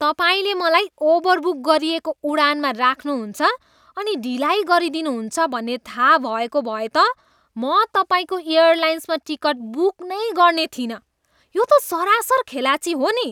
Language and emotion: Nepali, disgusted